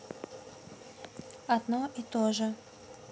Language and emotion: Russian, neutral